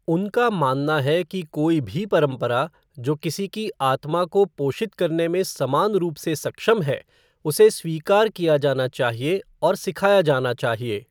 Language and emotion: Hindi, neutral